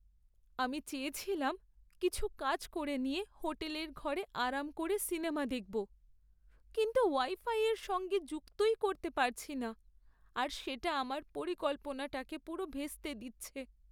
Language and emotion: Bengali, sad